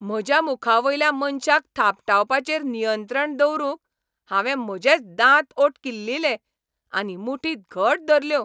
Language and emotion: Goan Konkani, angry